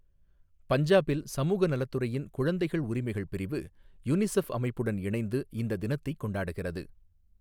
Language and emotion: Tamil, neutral